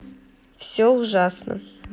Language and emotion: Russian, sad